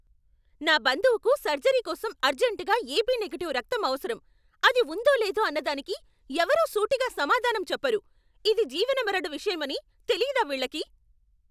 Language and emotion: Telugu, angry